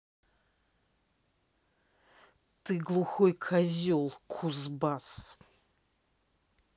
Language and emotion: Russian, angry